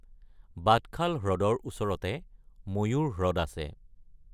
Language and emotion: Assamese, neutral